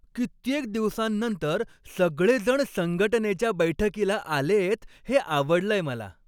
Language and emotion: Marathi, happy